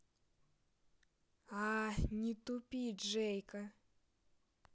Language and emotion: Russian, neutral